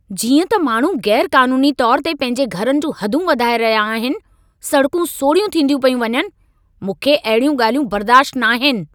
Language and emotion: Sindhi, angry